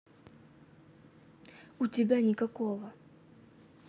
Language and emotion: Russian, neutral